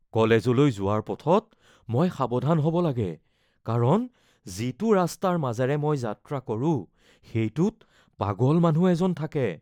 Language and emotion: Assamese, fearful